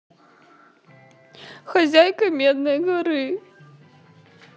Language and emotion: Russian, sad